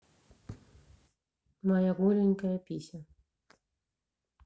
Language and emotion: Russian, neutral